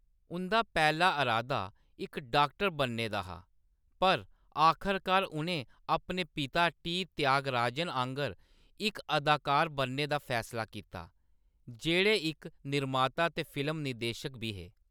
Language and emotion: Dogri, neutral